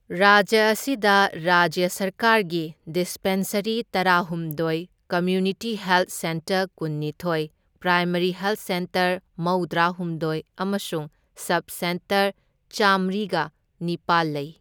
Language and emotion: Manipuri, neutral